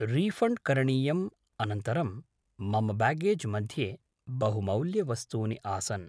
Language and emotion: Sanskrit, neutral